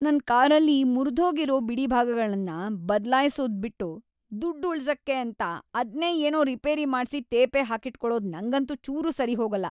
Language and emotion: Kannada, disgusted